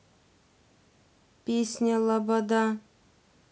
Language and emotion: Russian, neutral